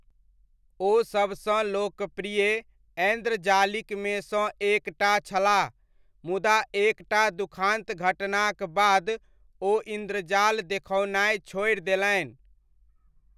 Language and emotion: Maithili, neutral